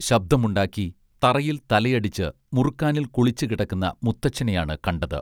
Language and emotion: Malayalam, neutral